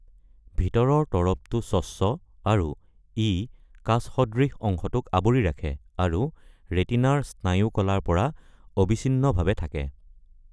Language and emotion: Assamese, neutral